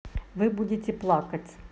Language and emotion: Russian, neutral